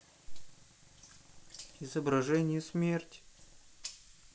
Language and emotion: Russian, sad